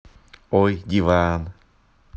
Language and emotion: Russian, positive